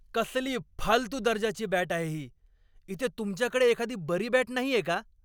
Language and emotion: Marathi, angry